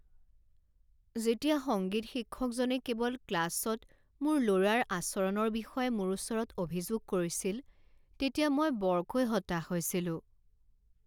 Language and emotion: Assamese, sad